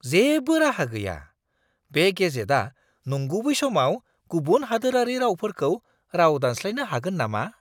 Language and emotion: Bodo, surprised